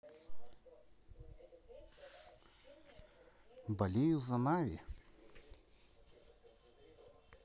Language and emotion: Russian, neutral